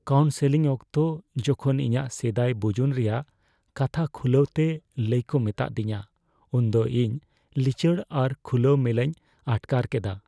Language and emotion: Santali, fearful